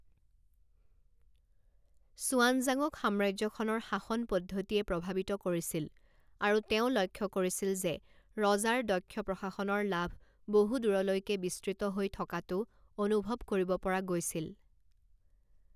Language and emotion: Assamese, neutral